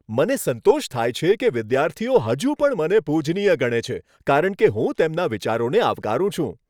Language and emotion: Gujarati, happy